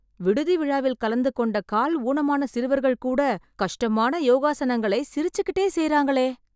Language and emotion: Tamil, surprised